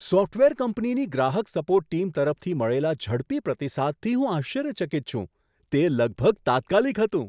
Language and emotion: Gujarati, surprised